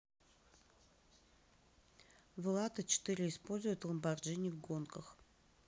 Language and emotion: Russian, neutral